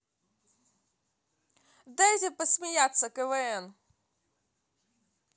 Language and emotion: Russian, positive